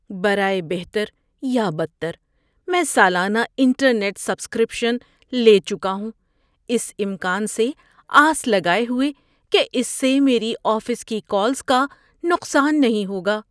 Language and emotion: Urdu, fearful